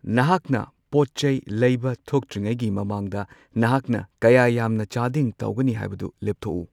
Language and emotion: Manipuri, neutral